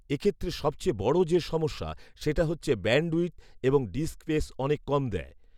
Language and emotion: Bengali, neutral